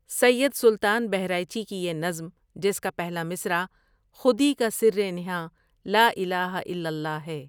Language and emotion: Urdu, neutral